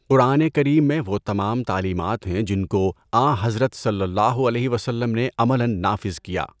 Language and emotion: Urdu, neutral